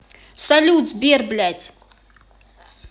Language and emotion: Russian, angry